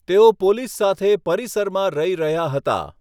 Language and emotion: Gujarati, neutral